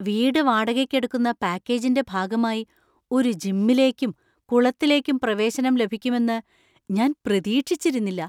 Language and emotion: Malayalam, surprised